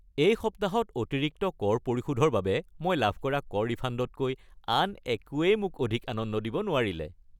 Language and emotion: Assamese, happy